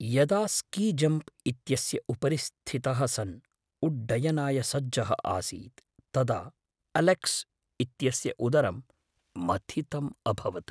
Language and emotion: Sanskrit, fearful